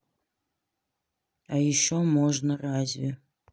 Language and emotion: Russian, sad